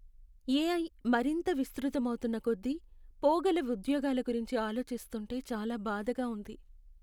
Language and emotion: Telugu, sad